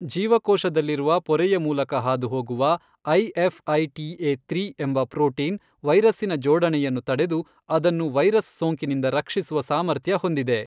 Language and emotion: Kannada, neutral